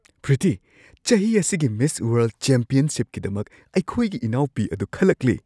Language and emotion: Manipuri, surprised